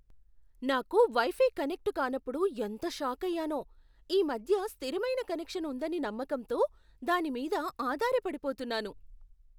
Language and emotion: Telugu, surprised